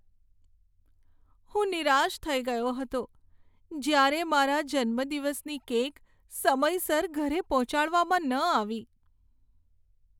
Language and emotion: Gujarati, sad